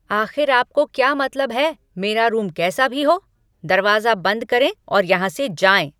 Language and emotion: Hindi, angry